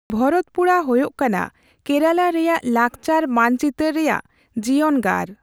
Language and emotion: Santali, neutral